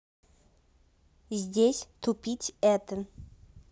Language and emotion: Russian, neutral